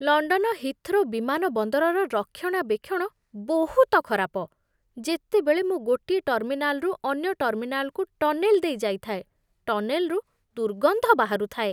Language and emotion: Odia, disgusted